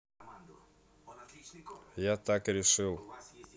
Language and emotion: Russian, neutral